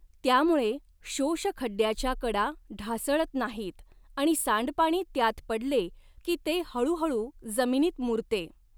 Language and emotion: Marathi, neutral